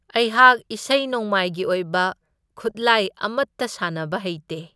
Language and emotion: Manipuri, neutral